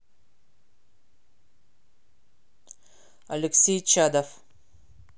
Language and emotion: Russian, angry